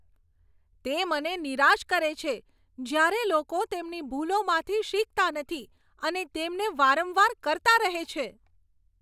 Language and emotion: Gujarati, angry